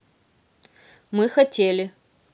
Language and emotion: Russian, neutral